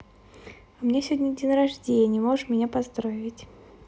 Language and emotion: Russian, positive